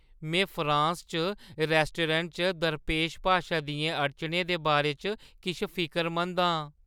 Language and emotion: Dogri, fearful